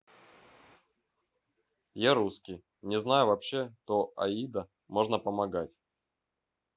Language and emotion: Russian, neutral